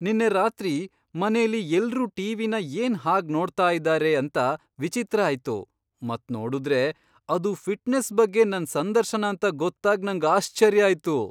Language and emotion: Kannada, surprised